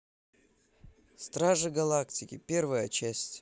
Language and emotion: Russian, neutral